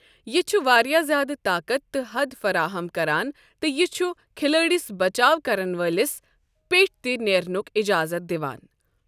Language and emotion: Kashmiri, neutral